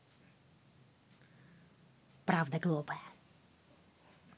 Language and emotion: Russian, angry